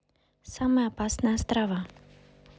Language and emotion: Russian, neutral